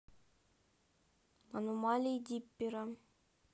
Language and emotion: Russian, neutral